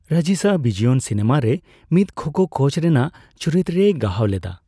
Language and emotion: Santali, neutral